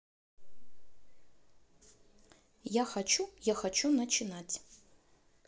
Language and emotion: Russian, neutral